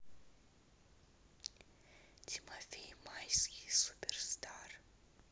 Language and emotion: Russian, neutral